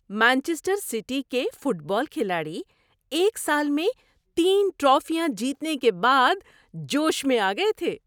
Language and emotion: Urdu, happy